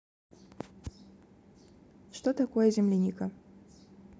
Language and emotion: Russian, neutral